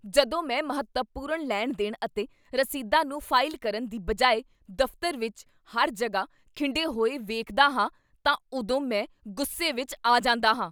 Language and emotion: Punjabi, angry